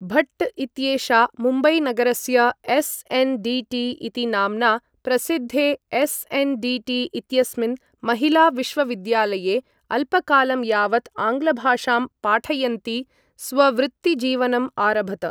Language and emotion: Sanskrit, neutral